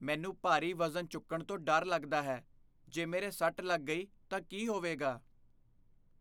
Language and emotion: Punjabi, fearful